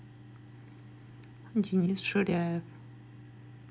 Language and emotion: Russian, neutral